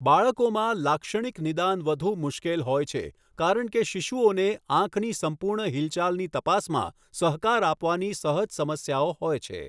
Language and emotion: Gujarati, neutral